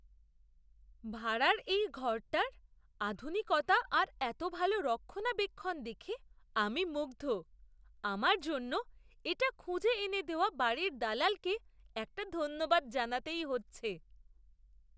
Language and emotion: Bengali, surprised